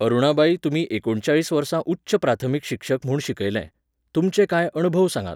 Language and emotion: Goan Konkani, neutral